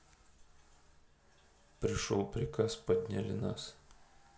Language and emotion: Russian, neutral